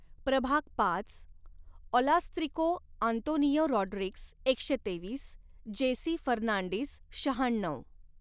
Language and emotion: Marathi, neutral